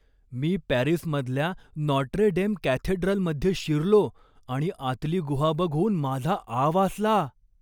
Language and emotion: Marathi, surprised